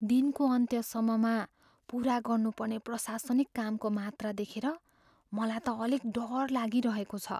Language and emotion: Nepali, fearful